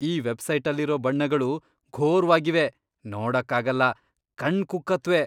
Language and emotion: Kannada, disgusted